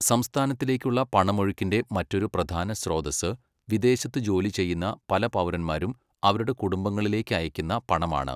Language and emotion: Malayalam, neutral